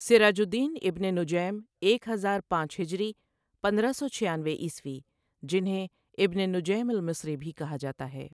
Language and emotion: Urdu, neutral